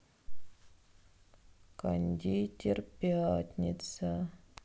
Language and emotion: Russian, sad